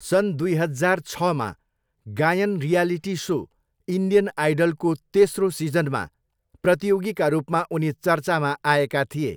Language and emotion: Nepali, neutral